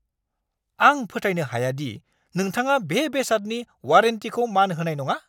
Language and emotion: Bodo, angry